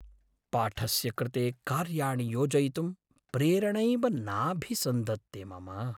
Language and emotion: Sanskrit, sad